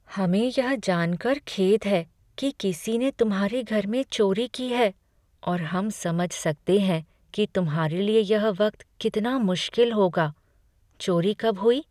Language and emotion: Hindi, sad